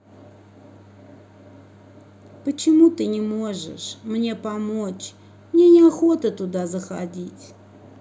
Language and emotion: Russian, sad